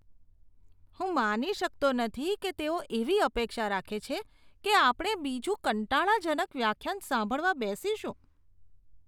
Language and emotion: Gujarati, disgusted